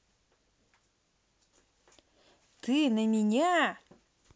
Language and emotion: Russian, angry